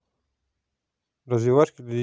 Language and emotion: Russian, neutral